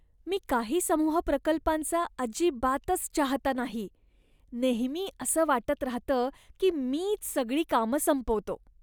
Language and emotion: Marathi, disgusted